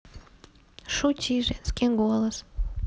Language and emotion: Russian, neutral